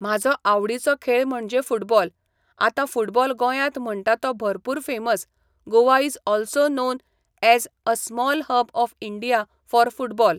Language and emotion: Goan Konkani, neutral